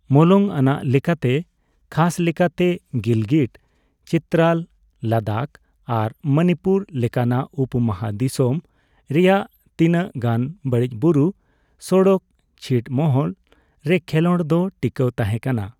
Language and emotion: Santali, neutral